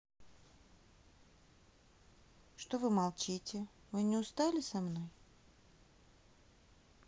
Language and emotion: Russian, sad